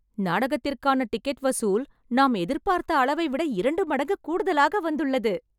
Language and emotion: Tamil, happy